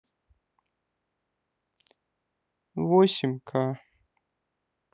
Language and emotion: Russian, sad